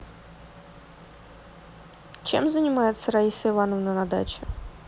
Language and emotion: Russian, neutral